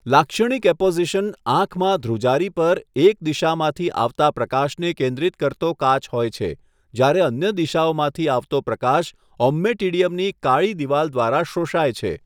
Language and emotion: Gujarati, neutral